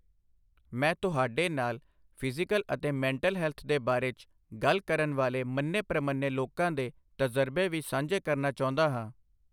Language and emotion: Punjabi, neutral